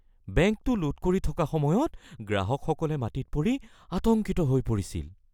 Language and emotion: Assamese, fearful